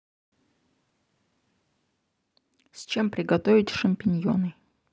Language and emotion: Russian, neutral